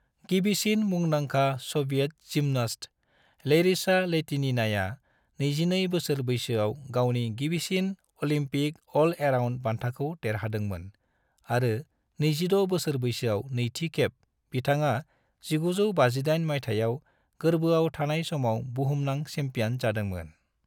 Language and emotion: Bodo, neutral